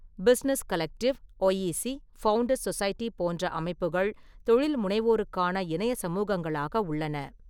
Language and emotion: Tamil, neutral